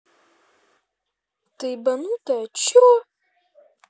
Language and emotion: Russian, angry